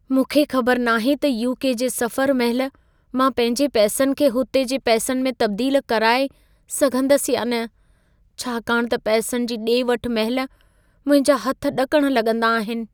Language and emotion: Sindhi, fearful